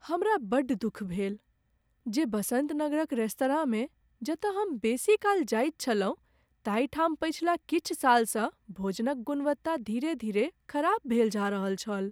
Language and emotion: Maithili, sad